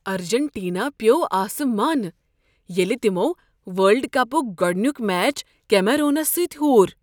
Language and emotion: Kashmiri, surprised